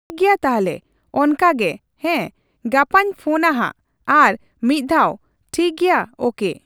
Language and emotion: Santali, neutral